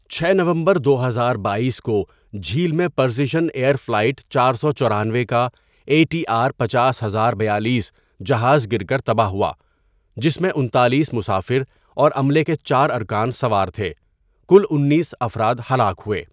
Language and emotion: Urdu, neutral